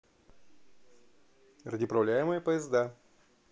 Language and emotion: Russian, neutral